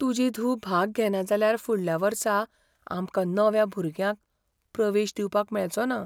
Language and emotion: Goan Konkani, fearful